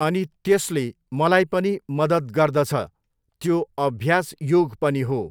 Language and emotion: Nepali, neutral